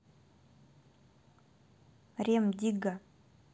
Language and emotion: Russian, neutral